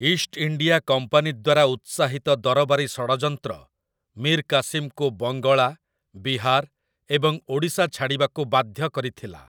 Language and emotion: Odia, neutral